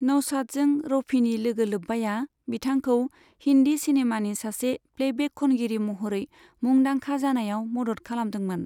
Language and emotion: Bodo, neutral